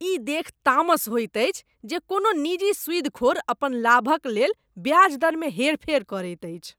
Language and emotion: Maithili, disgusted